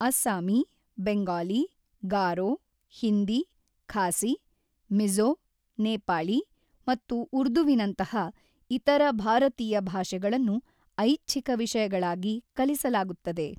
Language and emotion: Kannada, neutral